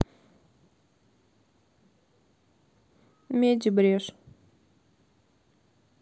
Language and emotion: Russian, sad